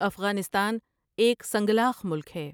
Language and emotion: Urdu, neutral